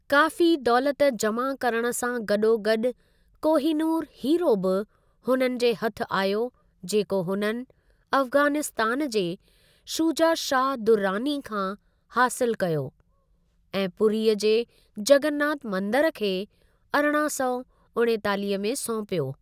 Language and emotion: Sindhi, neutral